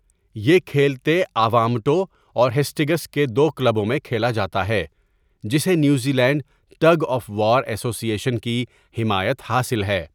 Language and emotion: Urdu, neutral